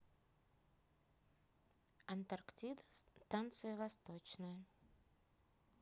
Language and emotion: Russian, neutral